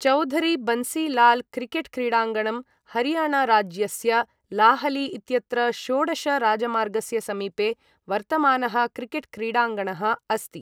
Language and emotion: Sanskrit, neutral